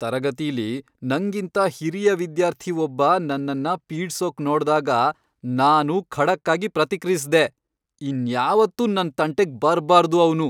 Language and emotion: Kannada, angry